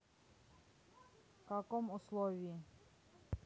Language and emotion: Russian, neutral